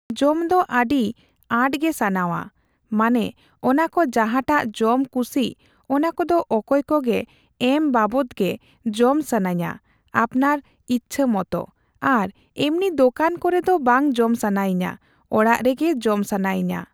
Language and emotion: Santali, neutral